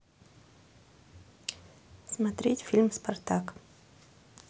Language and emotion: Russian, neutral